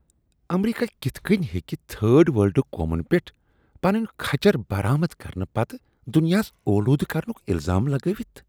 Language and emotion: Kashmiri, disgusted